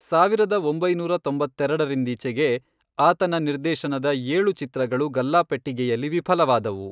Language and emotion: Kannada, neutral